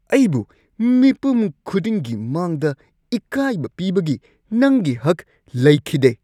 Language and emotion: Manipuri, angry